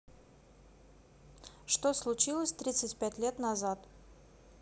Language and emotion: Russian, neutral